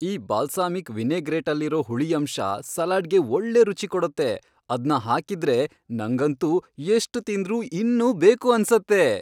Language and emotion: Kannada, happy